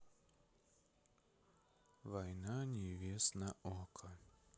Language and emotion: Russian, sad